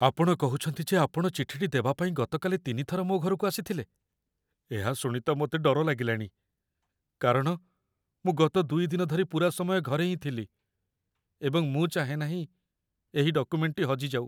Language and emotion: Odia, fearful